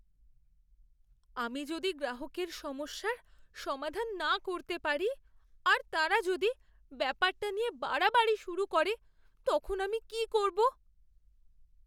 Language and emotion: Bengali, fearful